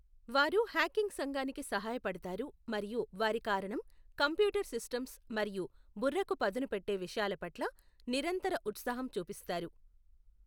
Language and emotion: Telugu, neutral